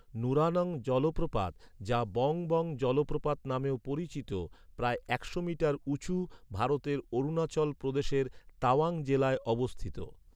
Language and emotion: Bengali, neutral